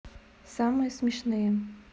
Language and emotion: Russian, neutral